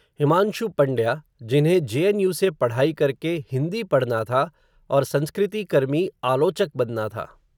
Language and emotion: Hindi, neutral